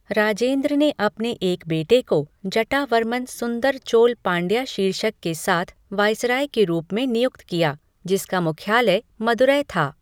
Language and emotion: Hindi, neutral